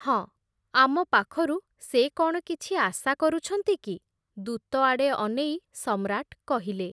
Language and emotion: Odia, neutral